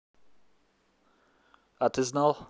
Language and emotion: Russian, neutral